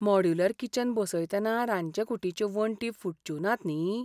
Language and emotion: Goan Konkani, fearful